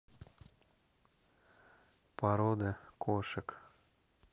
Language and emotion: Russian, neutral